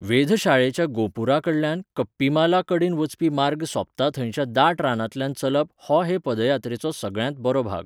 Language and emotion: Goan Konkani, neutral